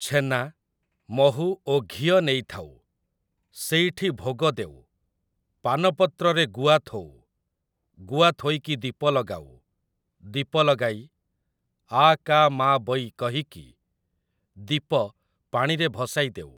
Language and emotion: Odia, neutral